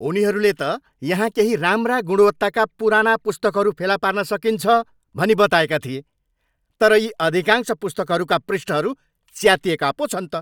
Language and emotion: Nepali, angry